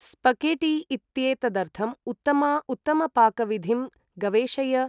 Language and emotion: Sanskrit, neutral